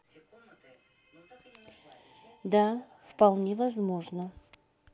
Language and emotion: Russian, neutral